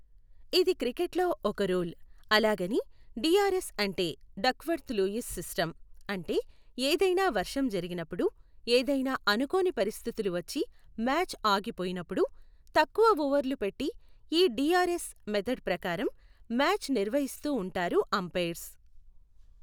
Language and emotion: Telugu, neutral